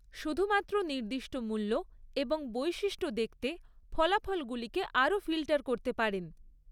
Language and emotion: Bengali, neutral